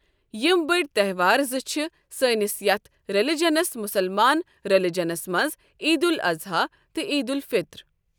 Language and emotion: Kashmiri, neutral